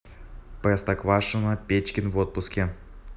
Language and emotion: Russian, neutral